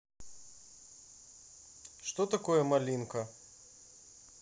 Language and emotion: Russian, neutral